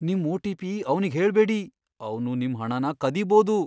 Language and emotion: Kannada, fearful